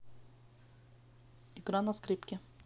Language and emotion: Russian, neutral